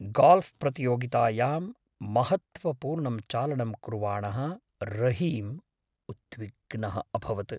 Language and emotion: Sanskrit, fearful